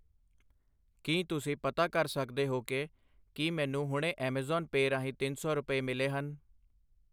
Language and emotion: Punjabi, neutral